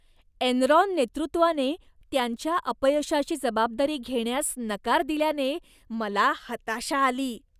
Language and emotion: Marathi, disgusted